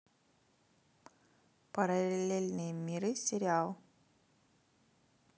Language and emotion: Russian, neutral